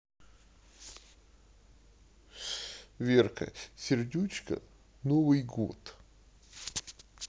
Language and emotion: Russian, sad